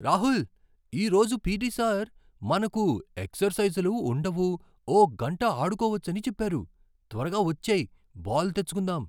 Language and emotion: Telugu, surprised